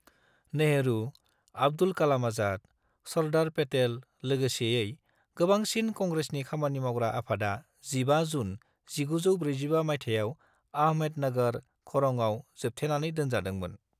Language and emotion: Bodo, neutral